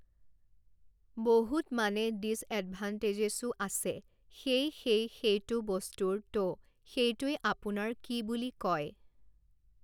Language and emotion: Assamese, neutral